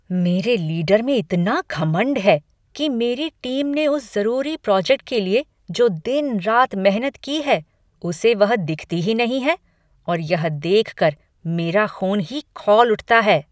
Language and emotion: Hindi, angry